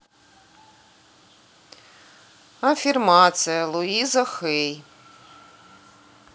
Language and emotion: Russian, neutral